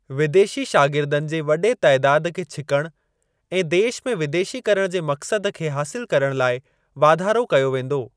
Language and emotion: Sindhi, neutral